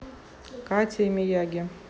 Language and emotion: Russian, neutral